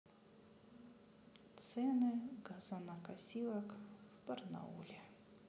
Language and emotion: Russian, sad